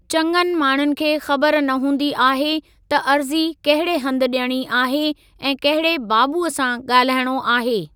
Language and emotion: Sindhi, neutral